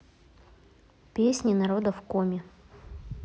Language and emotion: Russian, neutral